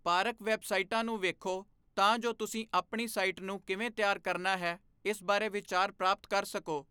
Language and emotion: Punjabi, neutral